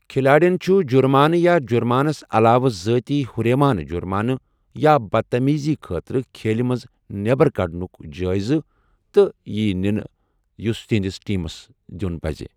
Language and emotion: Kashmiri, neutral